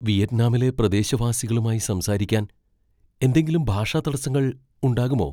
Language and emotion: Malayalam, fearful